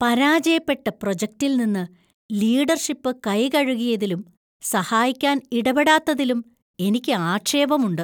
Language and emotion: Malayalam, disgusted